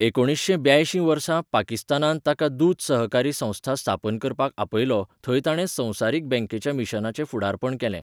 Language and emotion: Goan Konkani, neutral